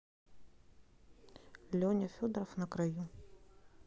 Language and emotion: Russian, neutral